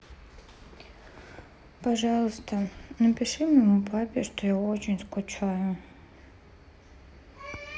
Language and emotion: Russian, sad